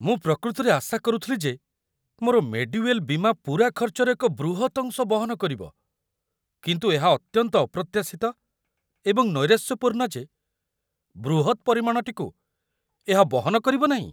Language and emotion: Odia, surprised